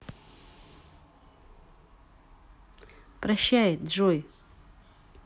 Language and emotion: Russian, neutral